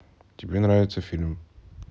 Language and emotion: Russian, neutral